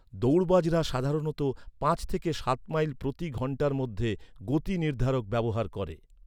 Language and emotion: Bengali, neutral